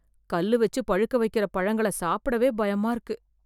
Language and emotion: Tamil, fearful